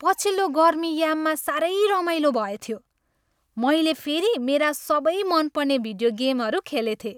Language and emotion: Nepali, happy